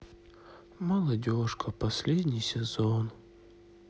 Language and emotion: Russian, sad